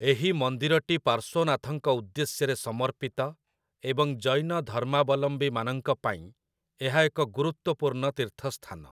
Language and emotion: Odia, neutral